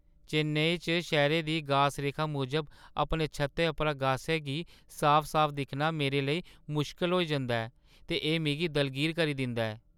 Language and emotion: Dogri, sad